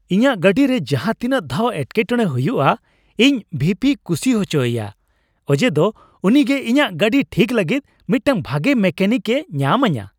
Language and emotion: Santali, happy